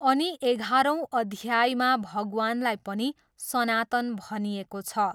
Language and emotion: Nepali, neutral